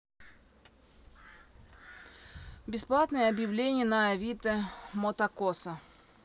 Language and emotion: Russian, neutral